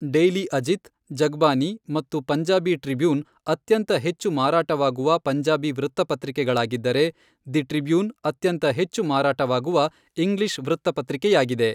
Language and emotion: Kannada, neutral